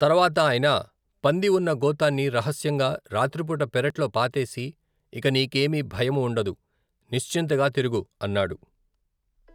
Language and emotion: Telugu, neutral